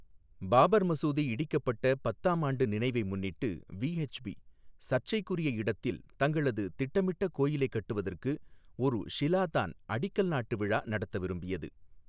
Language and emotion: Tamil, neutral